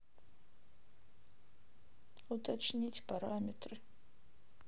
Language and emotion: Russian, sad